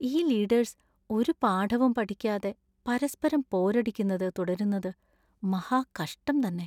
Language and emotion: Malayalam, sad